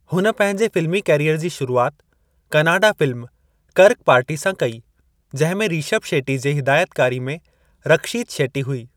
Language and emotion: Sindhi, neutral